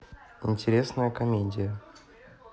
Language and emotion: Russian, neutral